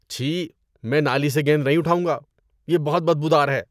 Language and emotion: Urdu, disgusted